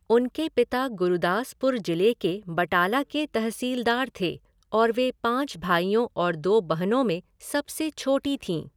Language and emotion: Hindi, neutral